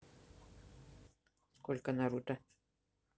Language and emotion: Russian, neutral